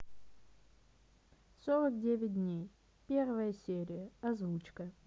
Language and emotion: Russian, neutral